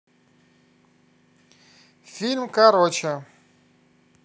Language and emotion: Russian, positive